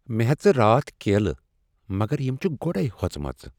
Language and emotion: Kashmiri, sad